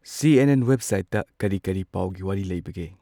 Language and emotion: Manipuri, neutral